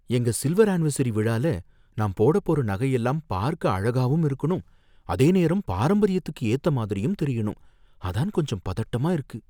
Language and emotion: Tamil, fearful